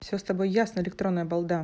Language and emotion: Russian, angry